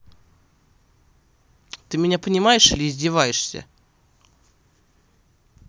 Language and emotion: Russian, angry